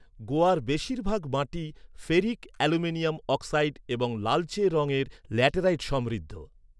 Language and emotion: Bengali, neutral